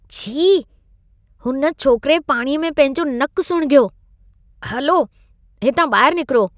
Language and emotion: Sindhi, disgusted